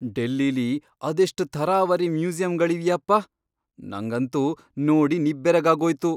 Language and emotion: Kannada, surprised